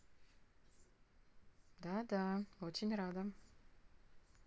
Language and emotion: Russian, neutral